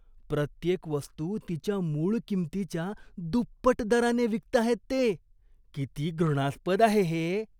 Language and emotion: Marathi, disgusted